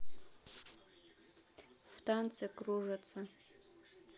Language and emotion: Russian, neutral